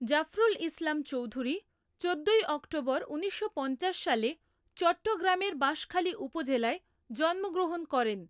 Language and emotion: Bengali, neutral